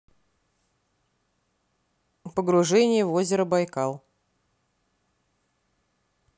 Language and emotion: Russian, neutral